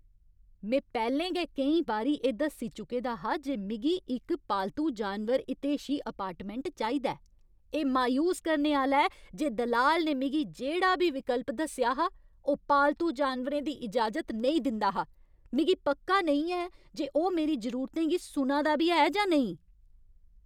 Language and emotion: Dogri, angry